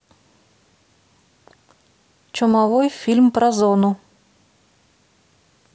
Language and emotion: Russian, neutral